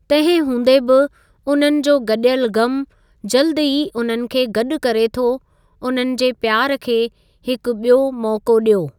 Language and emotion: Sindhi, neutral